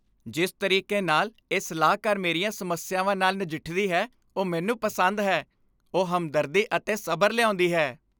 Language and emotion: Punjabi, happy